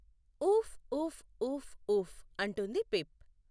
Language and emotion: Telugu, neutral